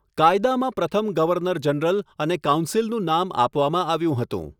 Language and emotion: Gujarati, neutral